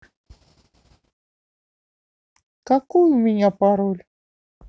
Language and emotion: Russian, neutral